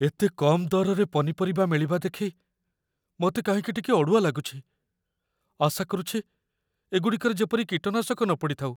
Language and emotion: Odia, fearful